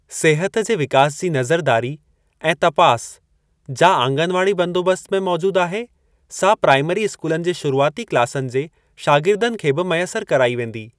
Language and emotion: Sindhi, neutral